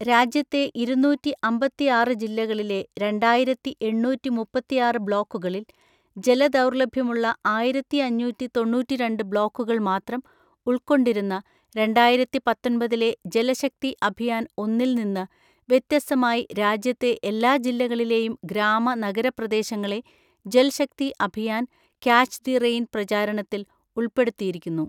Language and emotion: Malayalam, neutral